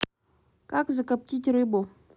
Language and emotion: Russian, neutral